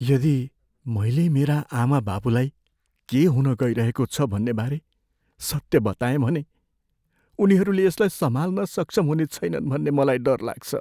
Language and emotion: Nepali, fearful